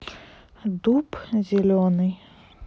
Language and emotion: Russian, neutral